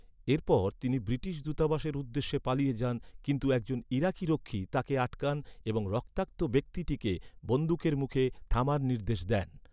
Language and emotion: Bengali, neutral